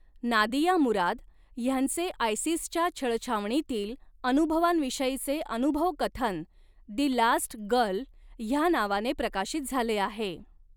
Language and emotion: Marathi, neutral